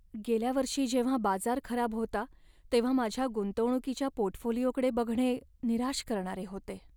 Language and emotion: Marathi, sad